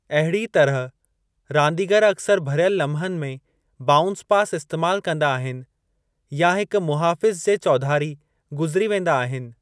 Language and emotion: Sindhi, neutral